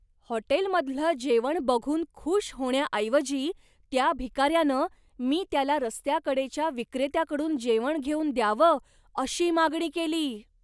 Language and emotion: Marathi, surprised